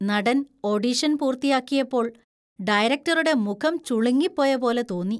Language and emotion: Malayalam, disgusted